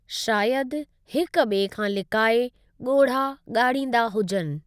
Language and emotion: Sindhi, neutral